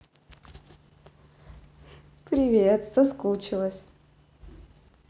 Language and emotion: Russian, positive